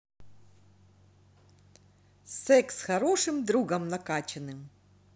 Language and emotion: Russian, positive